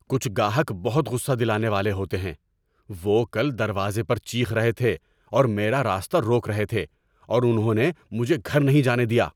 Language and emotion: Urdu, angry